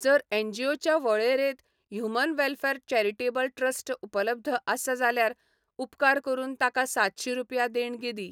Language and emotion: Goan Konkani, neutral